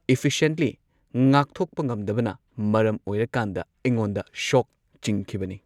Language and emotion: Manipuri, neutral